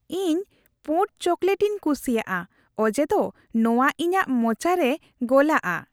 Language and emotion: Santali, happy